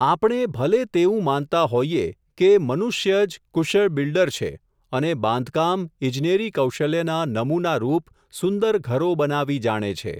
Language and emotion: Gujarati, neutral